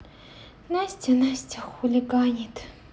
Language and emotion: Russian, sad